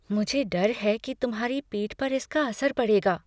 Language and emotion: Hindi, fearful